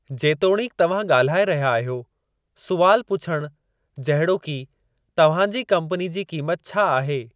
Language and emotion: Sindhi, neutral